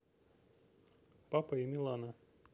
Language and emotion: Russian, neutral